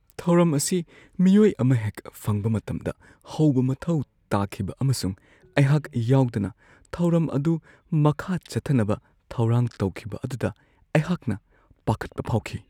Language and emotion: Manipuri, fearful